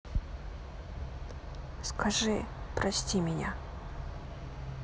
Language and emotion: Russian, sad